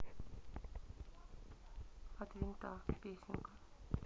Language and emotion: Russian, neutral